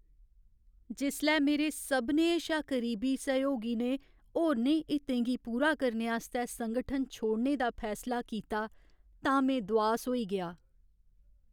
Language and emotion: Dogri, sad